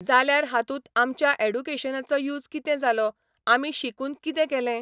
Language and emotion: Goan Konkani, neutral